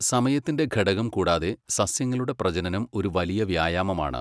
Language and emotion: Malayalam, neutral